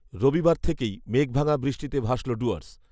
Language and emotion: Bengali, neutral